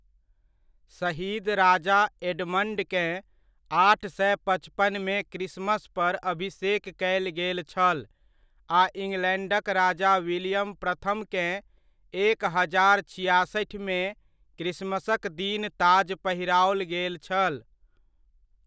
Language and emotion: Maithili, neutral